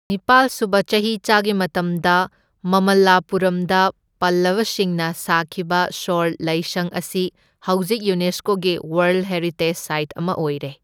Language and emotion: Manipuri, neutral